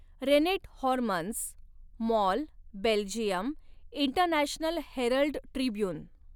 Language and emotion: Marathi, neutral